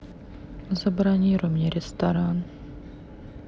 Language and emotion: Russian, sad